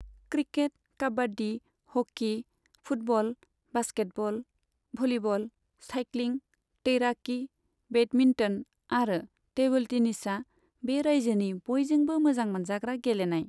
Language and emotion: Bodo, neutral